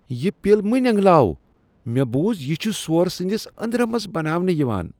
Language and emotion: Kashmiri, disgusted